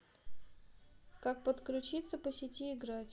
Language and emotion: Russian, neutral